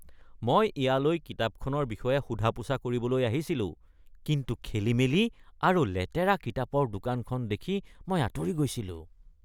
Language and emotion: Assamese, disgusted